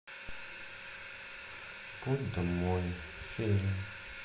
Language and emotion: Russian, sad